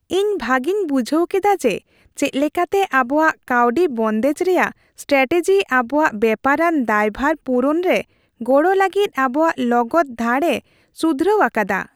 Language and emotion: Santali, happy